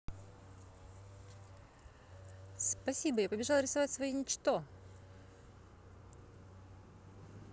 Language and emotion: Russian, positive